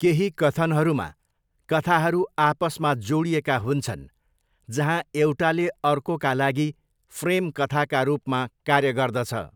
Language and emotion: Nepali, neutral